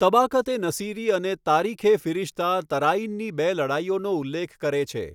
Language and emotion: Gujarati, neutral